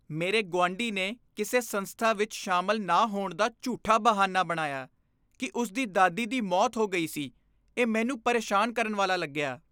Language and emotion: Punjabi, disgusted